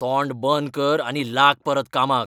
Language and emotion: Goan Konkani, angry